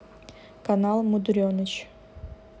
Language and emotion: Russian, neutral